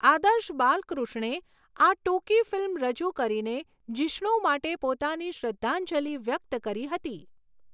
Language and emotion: Gujarati, neutral